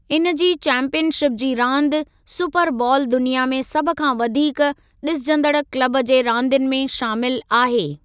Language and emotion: Sindhi, neutral